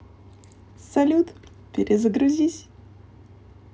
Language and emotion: Russian, positive